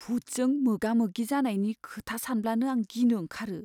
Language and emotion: Bodo, fearful